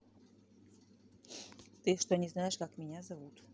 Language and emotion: Russian, neutral